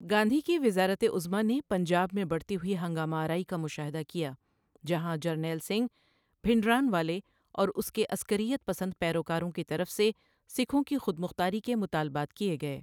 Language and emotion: Urdu, neutral